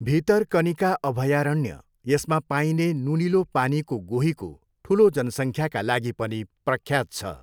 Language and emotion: Nepali, neutral